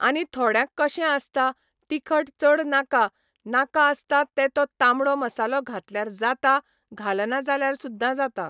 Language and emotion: Goan Konkani, neutral